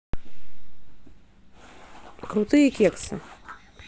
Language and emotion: Russian, neutral